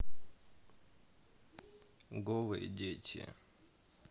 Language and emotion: Russian, neutral